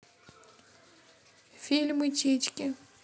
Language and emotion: Russian, neutral